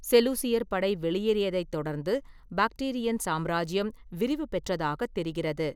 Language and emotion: Tamil, neutral